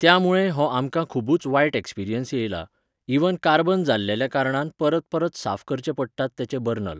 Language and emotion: Goan Konkani, neutral